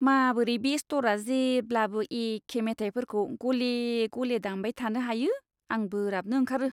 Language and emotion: Bodo, disgusted